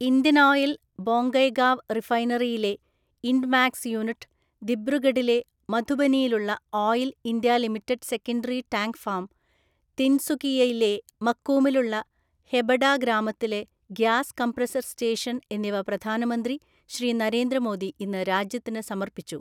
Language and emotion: Malayalam, neutral